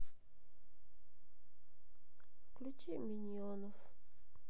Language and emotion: Russian, sad